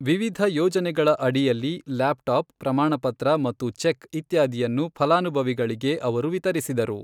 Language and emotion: Kannada, neutral